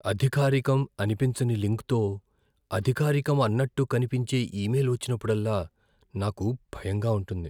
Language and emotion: Telugu, fearful